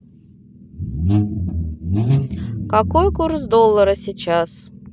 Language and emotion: Russian, neutral